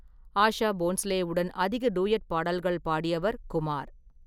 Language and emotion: Tamil, neutral